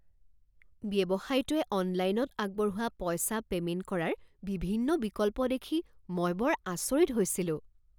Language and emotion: Assamese, surprised